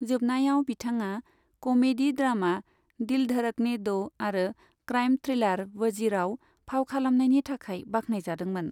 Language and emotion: Bodo, neutral